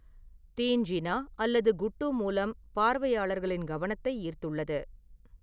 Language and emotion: Tamil, neutral